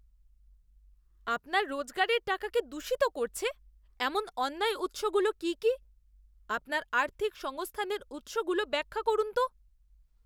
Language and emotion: Bengali, disgusted